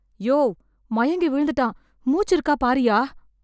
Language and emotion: Tamil, fearful